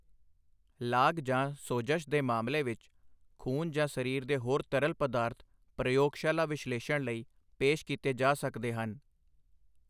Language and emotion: Punjabi, neutral